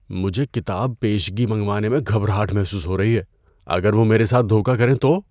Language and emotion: Urdu, fearful